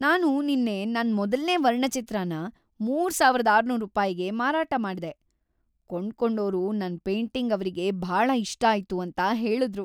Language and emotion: Kannada, happy